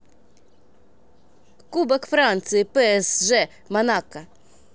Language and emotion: Russian, neutral